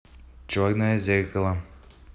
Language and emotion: Russian, neutral